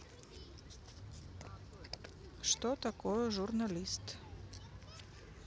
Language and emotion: Russian, neutral